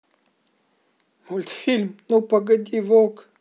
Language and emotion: Russian, sad